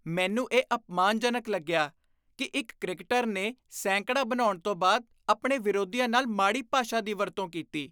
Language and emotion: Punjabi, disgusted